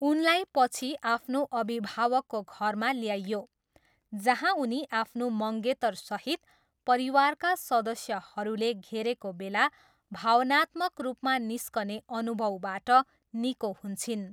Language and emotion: Nepali, neutral